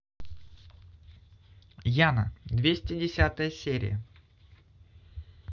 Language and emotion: Russian, positive